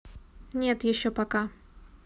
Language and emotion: Russian, neutral